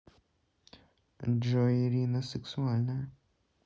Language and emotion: Russian, neutral